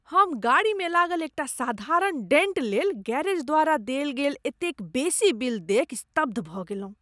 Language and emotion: Maithili, disgusted